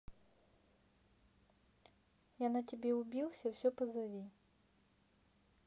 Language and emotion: Russian, neutral